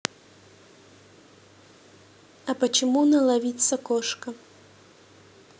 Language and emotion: Russian, neutral